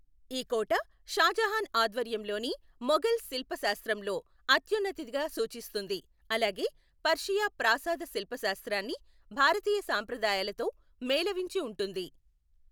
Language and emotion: Telugu, neutral